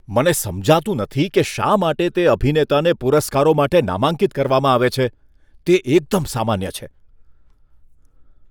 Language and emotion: Gujarati, disgusted